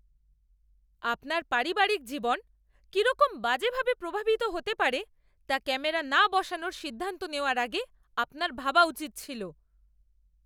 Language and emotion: Bengali, angry